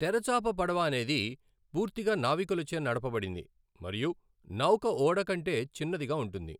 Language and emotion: Telugu, neutral